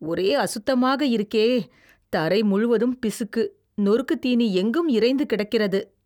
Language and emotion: Tamil, disgusted